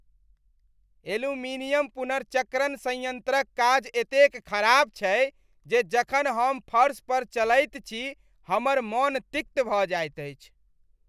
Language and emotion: Maithili, disgusted